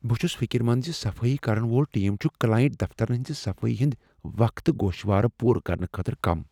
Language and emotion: Kashmiri, fearful